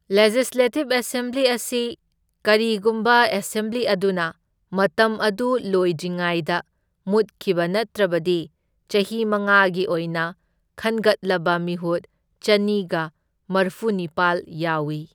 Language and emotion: Manipuri, neutral